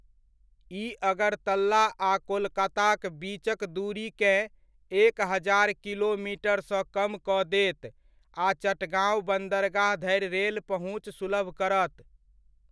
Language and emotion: Maithili, neutral